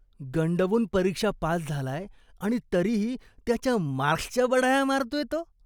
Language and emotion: Marathi, disgusted